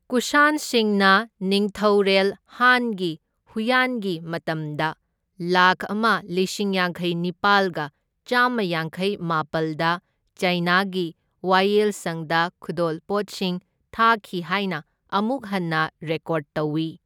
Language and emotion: Manipuri, neutral